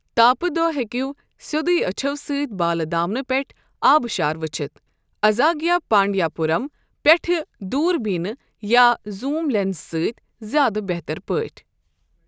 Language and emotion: Kashmiri, neutral